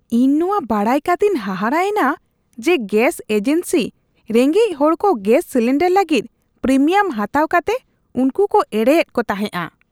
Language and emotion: Santali, disgusted